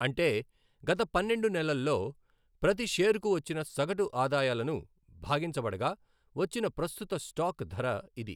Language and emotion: Telugu, neutral